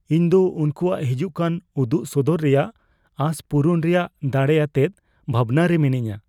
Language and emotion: Santali, fearful